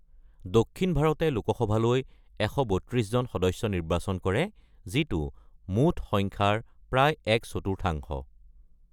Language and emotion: Assamese, neutral